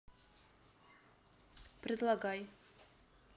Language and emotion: Russian, neutral